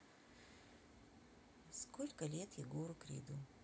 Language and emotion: Russian, neutral